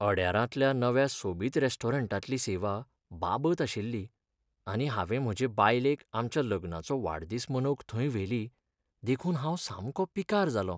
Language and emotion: Goan Konkani, sad